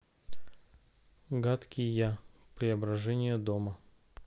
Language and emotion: Russian, neutral